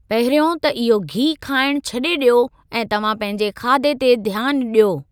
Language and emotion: Sindhi, neutral